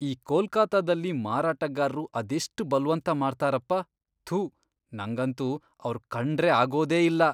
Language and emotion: Kannada, disgusted